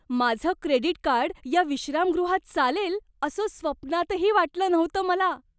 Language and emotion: Marathi, surprised